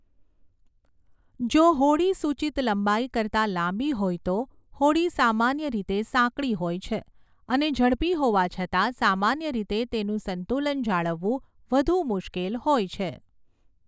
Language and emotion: Gujarati, neutral